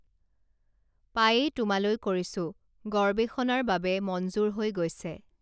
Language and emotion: Assamese, neutral